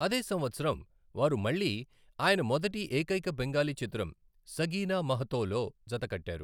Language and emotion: Telugu, neutral